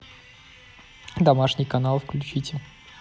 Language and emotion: Russian, neutral